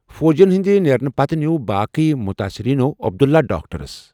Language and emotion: Kashmiri, neutral